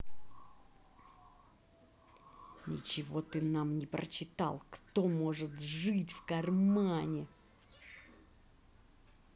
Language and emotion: Russian, angry